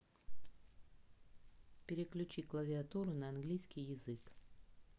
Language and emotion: Russian, neutral